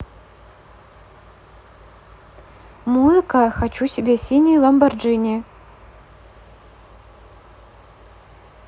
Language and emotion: Russian, neutral